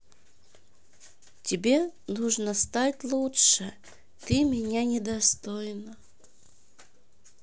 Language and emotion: Russian, neutral